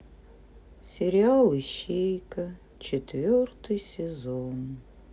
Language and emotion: Russian, sad